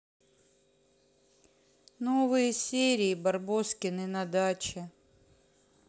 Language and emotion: Russian, sad